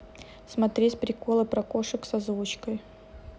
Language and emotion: Russian, neutral